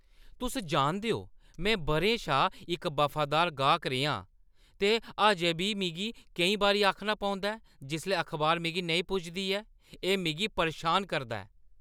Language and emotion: Dogri, angry